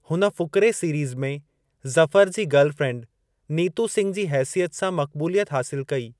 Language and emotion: Sindhi, neutral